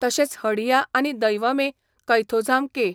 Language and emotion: Goan Konkani, neutral